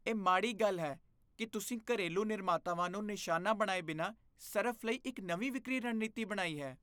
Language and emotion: Punjabi, disgusted